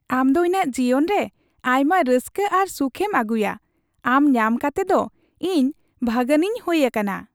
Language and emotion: Santali, happy